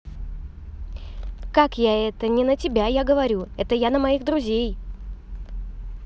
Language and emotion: Russian, angry